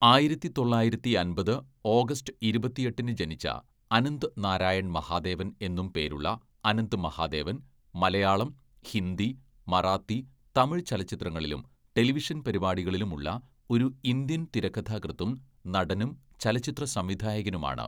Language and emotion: Malayalam, neutral